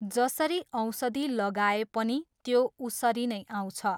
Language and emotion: Nepali, neutral